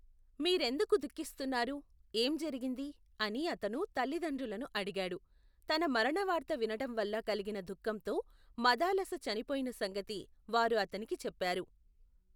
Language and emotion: Telugu, neutral